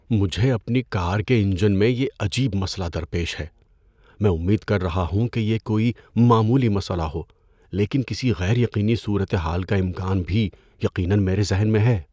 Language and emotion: Urdu, fearful